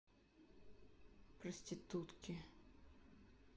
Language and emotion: Russian, neutral